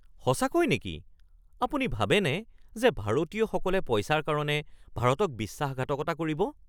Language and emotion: Assamese, surprised